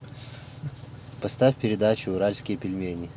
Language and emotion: Russian, neutral